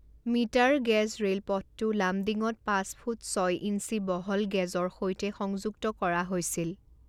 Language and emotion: Assamese, neutral